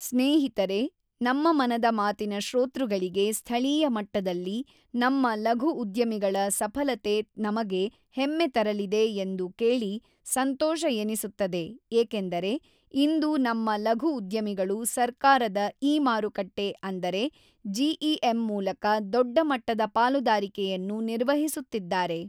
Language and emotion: Kannada, neutral